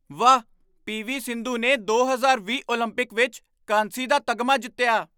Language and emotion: Punjabi, surprised